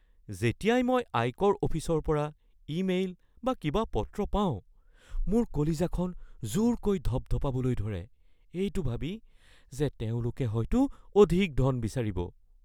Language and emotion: Assamese, fearful